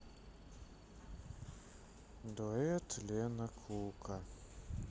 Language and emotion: Russian, sad